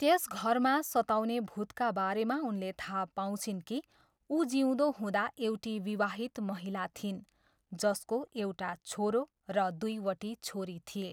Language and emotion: Nepali, neutral